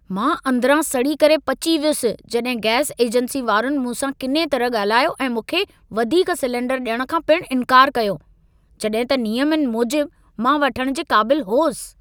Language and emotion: Sindhi, angry